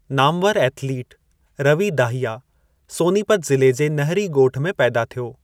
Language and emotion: Sindhi, neutral